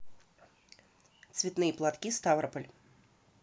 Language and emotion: Russian, neutral